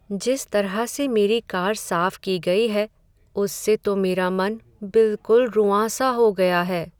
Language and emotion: Hindi, sad